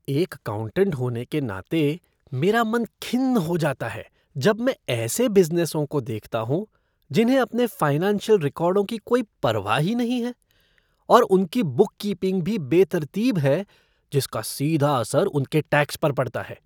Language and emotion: Hindi, disgusted